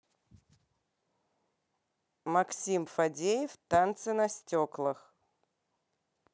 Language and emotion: Russian, neutral